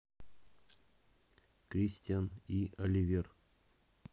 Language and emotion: Russian, neutral